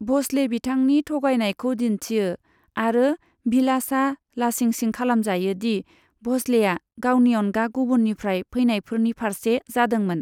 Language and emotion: Bodo, neutral